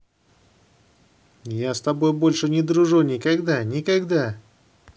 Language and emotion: Russian, angry